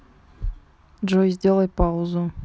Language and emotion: Russian, neutral